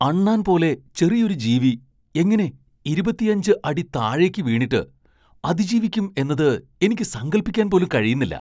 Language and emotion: Malayalam, surprised